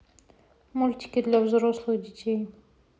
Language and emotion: Russian, neutral